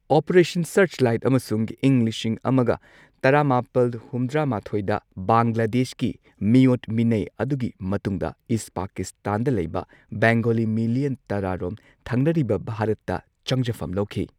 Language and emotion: Manipuri, neutral